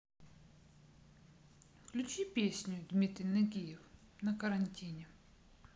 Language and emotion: Russian, neutral